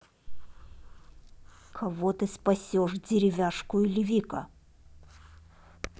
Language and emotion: Russian, angry